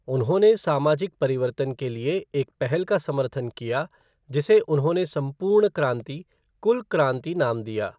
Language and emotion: Hindi, neutral